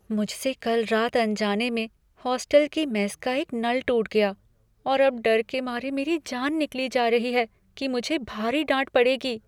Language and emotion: Hindi, fearful